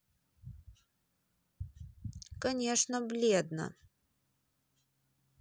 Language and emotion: Russian, neutral